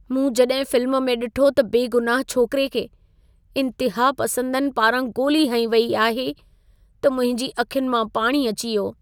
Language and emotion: Sindhi, sad